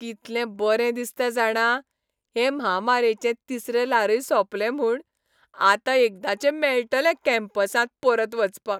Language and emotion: Goan Konkani, happy